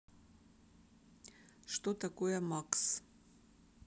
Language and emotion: Russian, neutral